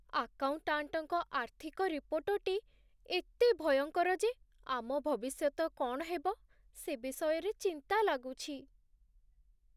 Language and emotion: Odia, sad